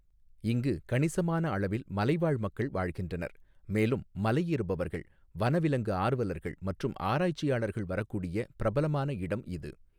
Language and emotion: Tamil, neutral